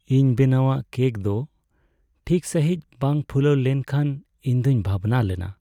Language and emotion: Santali, sad